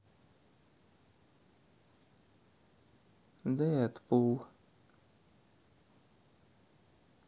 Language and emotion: Russian, sad